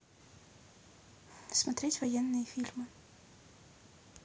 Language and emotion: Russian, neutral